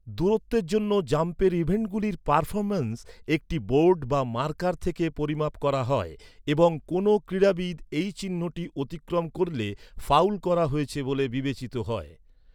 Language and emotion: Bengali, neutral